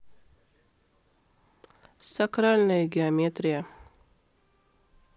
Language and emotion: Russian, neutral